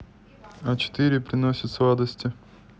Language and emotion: Russian, neutral